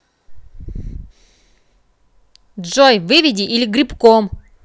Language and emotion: Russian, angry